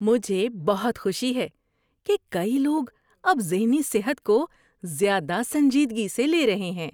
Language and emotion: Urdu, happy